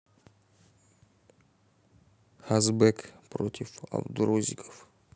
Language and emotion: Russian, neutral